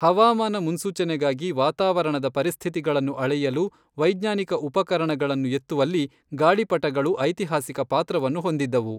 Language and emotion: Kannada, neutral